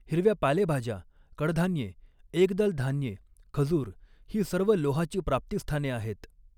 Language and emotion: Marathi, neutral